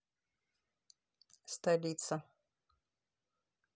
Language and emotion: Russian, neutral